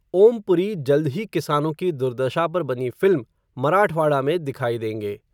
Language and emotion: Hindi, neutral